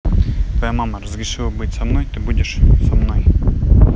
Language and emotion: Russian, neutral